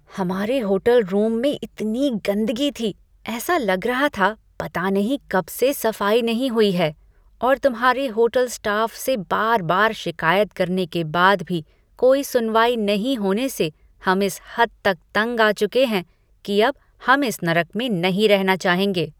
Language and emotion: Hindi, disgusted